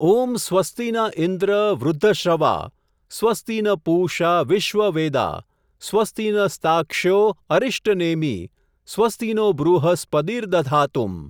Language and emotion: Gujarati, neutral